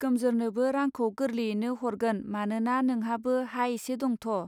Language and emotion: Bodo, neutral